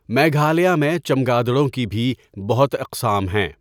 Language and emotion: Urdu, neutral